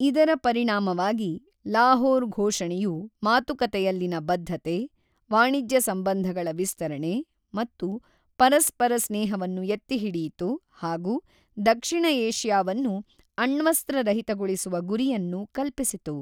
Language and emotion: Kannada, neutral